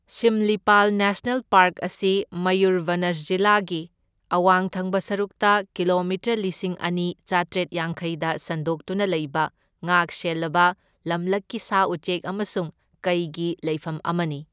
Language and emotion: Manipuri, neutral